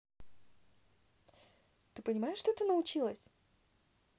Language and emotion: Russian, positive